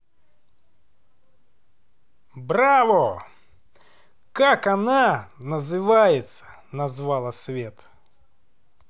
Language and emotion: Russian, positive